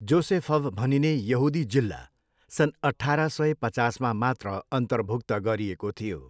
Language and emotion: Nepali, neutral